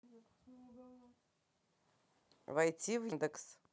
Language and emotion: Russian, neutral